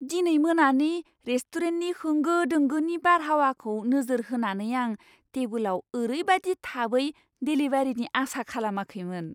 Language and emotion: Bodo, surprised